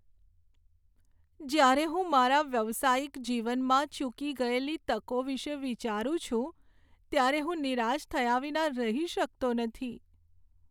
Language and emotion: Gujarati, sad